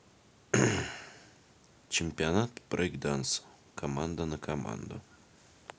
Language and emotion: Russian, neutral